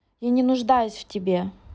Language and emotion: Russian, angry